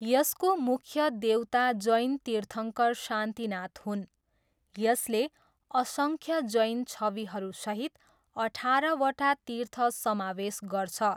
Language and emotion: Nepali, neutral